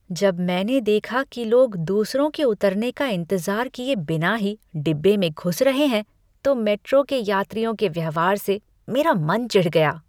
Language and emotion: Hindi, disgusted